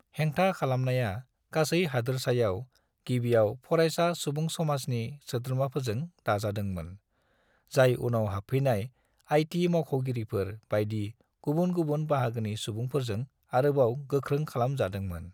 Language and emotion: Bodo, neutral